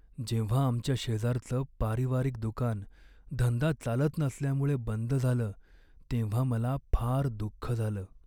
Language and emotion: Marathi, sad